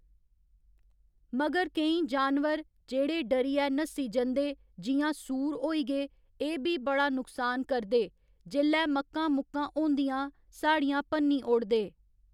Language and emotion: Dogri, neutral